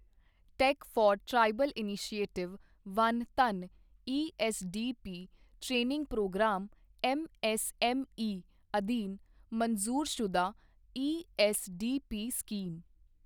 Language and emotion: Punjabi, neutral